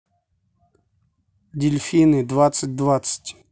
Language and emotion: Russian, neutral